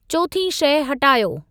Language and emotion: Sindhi, neutral